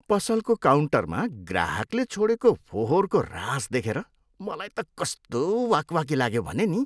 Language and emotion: Nepali, disgusted